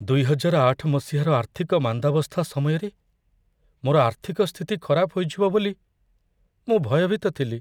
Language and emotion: Odia, fearful